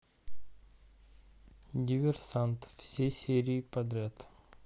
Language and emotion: Russian, neutral